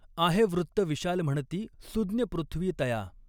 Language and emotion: Marathi, neutral